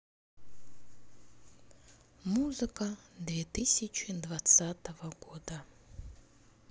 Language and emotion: Russian, sad